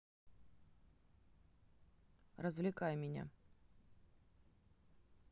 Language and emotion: Russian, neutral